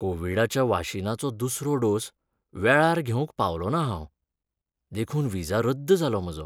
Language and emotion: Goan Konkani, sad